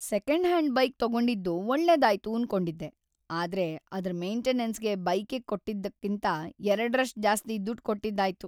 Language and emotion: Kannada, sad